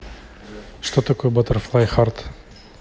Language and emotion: Russian, neutral